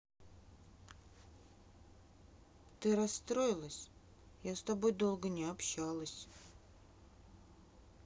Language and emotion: Russian, sad